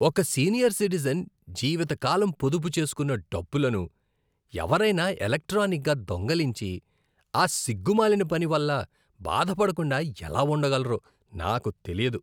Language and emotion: Telugu, disgusted